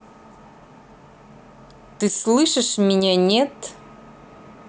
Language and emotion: Russian, angry